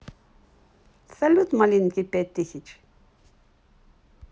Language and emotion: Russian, positive